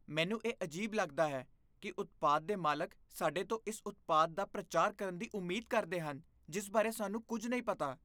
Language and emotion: Punjabi, disgusted